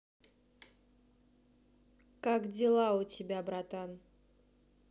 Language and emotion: Russian, neutral